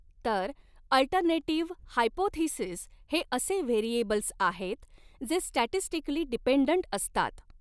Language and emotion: Marathi, neutral